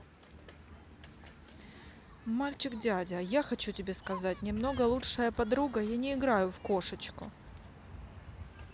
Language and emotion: Russian, neutral